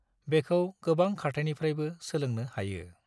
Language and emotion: Bodo, neutral